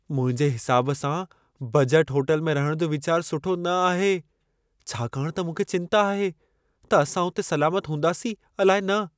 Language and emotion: Sindhi, fearful